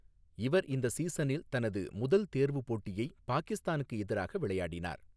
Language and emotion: Tamil, neutral